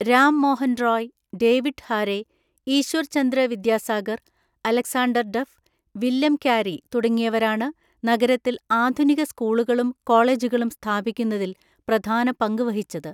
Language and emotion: Malayalam, neutral